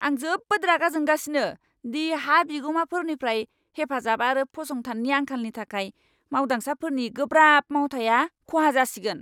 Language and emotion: Bodo, angry